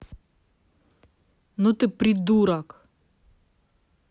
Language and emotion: Russian, angry